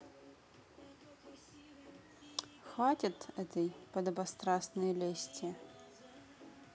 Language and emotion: Russian, neutral